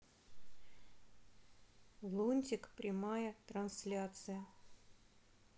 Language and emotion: Russian, neutral